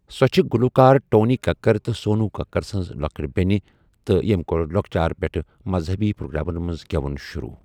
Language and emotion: Kashmiri, neutral